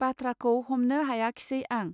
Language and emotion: Bodo, neutral